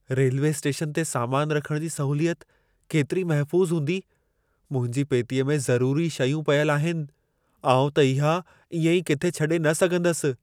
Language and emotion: Sindhi, fearful